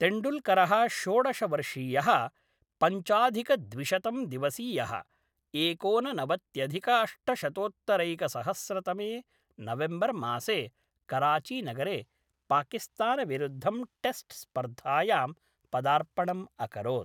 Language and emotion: Sanskrit, neutral